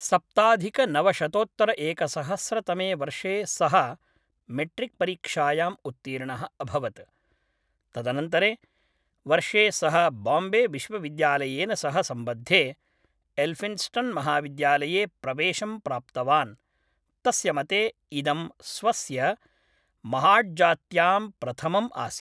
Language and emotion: Sanskrit, neutral